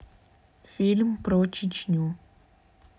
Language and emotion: Russian, neutral